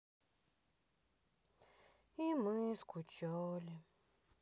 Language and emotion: Russian, sad